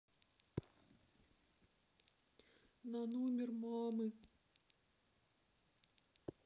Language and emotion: Russian, sad